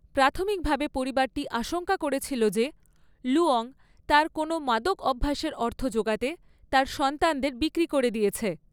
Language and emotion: Bengali, neutral